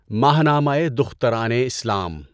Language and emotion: Urdu, neutral